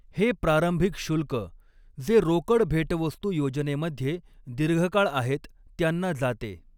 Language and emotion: Marathi, neutral